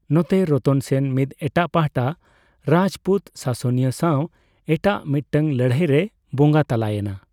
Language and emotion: Santali, neutral